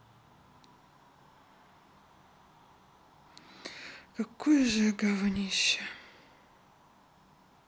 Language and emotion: Russian, sad